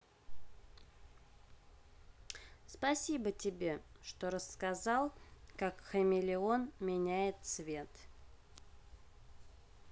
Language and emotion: Russian, neutral